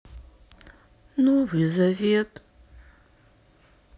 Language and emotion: Russian, sad